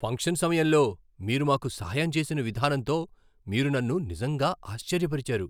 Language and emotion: Telugu, surprised